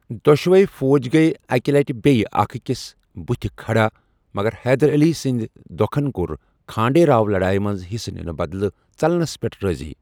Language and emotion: Kashmiri, neutral